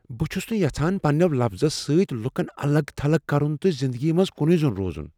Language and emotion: Kashmiri, fearful